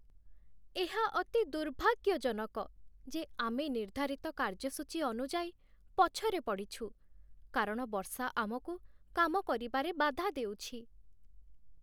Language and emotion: Odia, sad